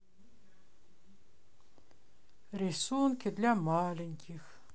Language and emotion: Russian, sad